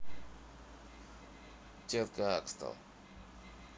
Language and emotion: Russian, neutral